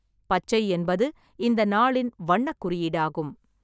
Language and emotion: Tamil, neutral